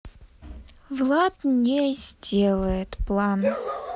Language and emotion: Russian, sad